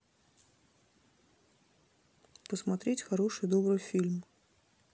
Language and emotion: Russian, neutral